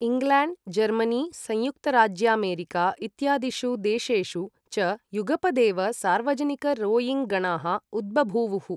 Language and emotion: Sanskrit, neutral